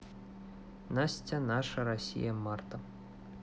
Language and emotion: Russian, neutral